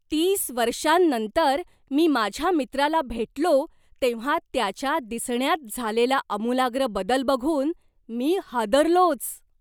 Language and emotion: Marathi, surprised